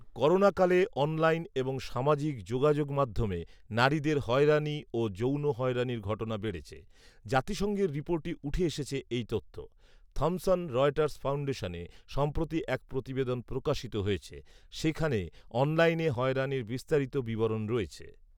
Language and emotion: Bengali, neutral